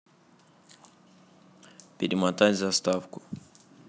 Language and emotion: Russian, neutral